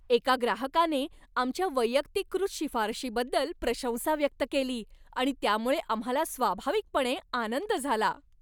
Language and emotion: Marathi, happy